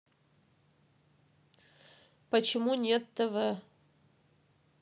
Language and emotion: Russian, neutral